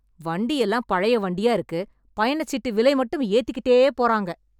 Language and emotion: Tamil, angry